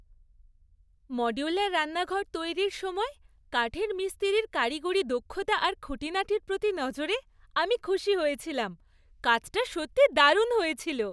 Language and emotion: Bengali, happy